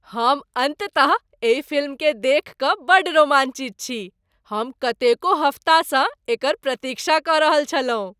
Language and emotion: Maithili, happy